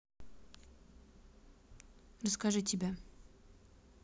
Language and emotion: Russian, neutral